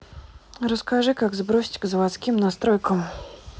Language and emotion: Russian, neutral